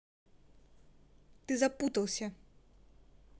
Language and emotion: Russian, angry